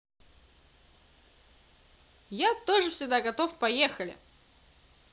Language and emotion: Russian, positive